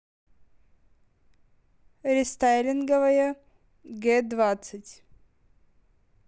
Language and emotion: Russian, neutral